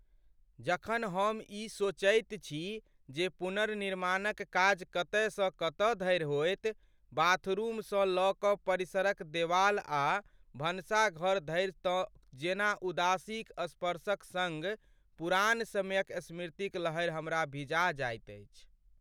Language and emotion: Maithili, sad